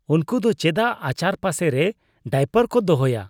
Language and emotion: Santali, disgusted